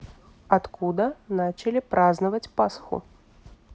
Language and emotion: Russian, neutral